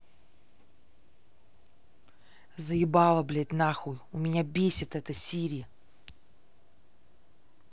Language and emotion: Russian, angry